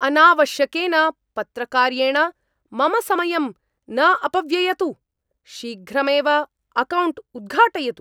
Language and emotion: Sanskrit, angry